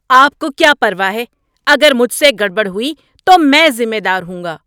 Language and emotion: Urdu, angry